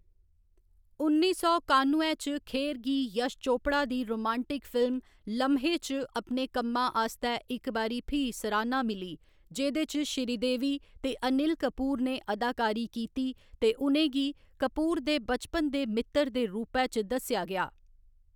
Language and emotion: Dogri, neutral